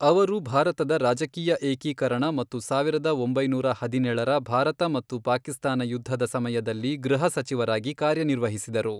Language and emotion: Kannada, neutral